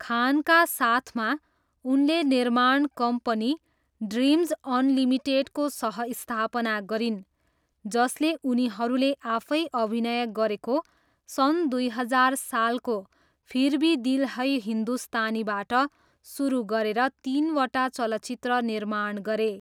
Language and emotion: Nepali, neutral